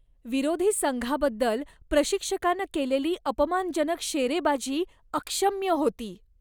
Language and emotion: Marathi, disgusted